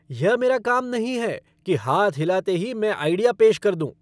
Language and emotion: Hindi, angry